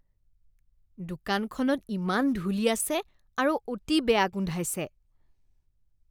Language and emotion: Assamese, disgusted